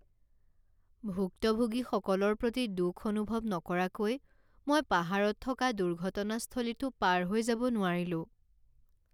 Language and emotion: Assamese, sad